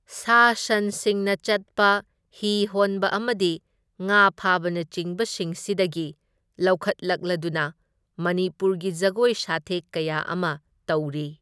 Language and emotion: Manipuri, neutral